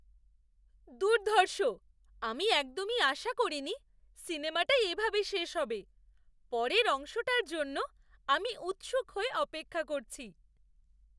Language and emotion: Bengali, surprised